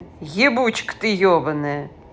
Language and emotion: Russian, angry